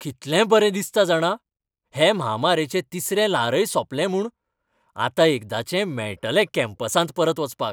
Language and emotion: Goan Konkani, happy